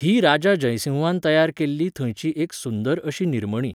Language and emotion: Goan Konkani, neutral